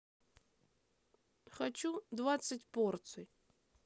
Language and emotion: Russian, neutral